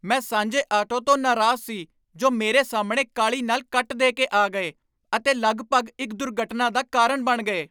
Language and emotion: Punjabi, angry